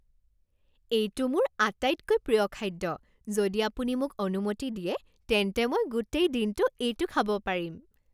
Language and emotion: Assamese, happy